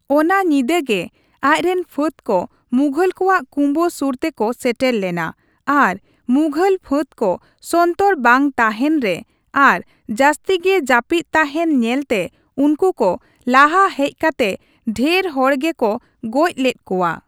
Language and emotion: Santali, neutral